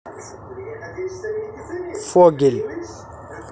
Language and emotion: Russian, neutral